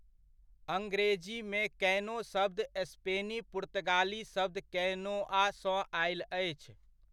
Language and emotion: Maithili, neutral